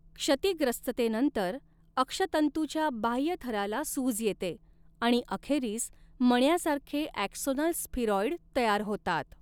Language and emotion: Marathi, neutral